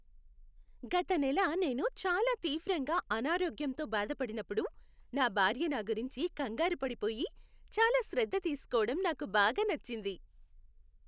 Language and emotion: Telugu, happy